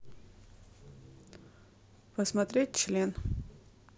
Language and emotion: Russian, neutral